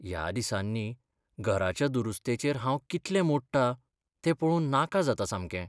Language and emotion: Goan Konkani, sad